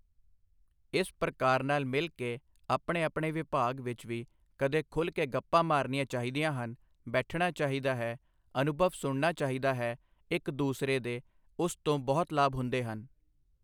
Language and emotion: Punjabi, neutral